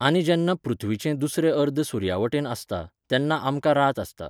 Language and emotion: Goan Konkani, neutral